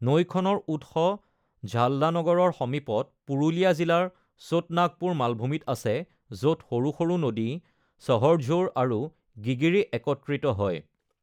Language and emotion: Assamese, neutral